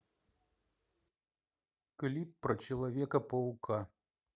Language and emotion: Russian, neutral